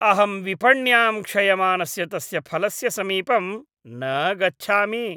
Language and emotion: Sanskrit, disgusted